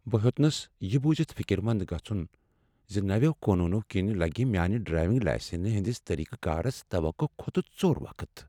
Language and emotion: Kashmiri, sad